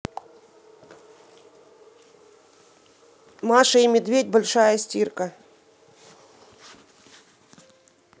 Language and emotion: Russian, neutral